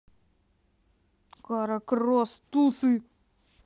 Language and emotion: Russian, angry